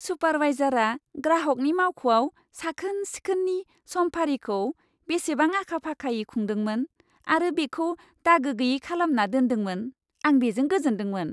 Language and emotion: Bodo, happy